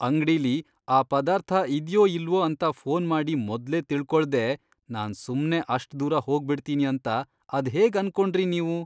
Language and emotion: Kannada, disgusted